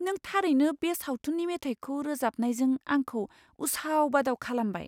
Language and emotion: Bodo, surprised